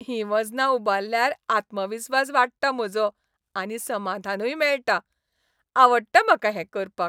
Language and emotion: Goan Konkani, happy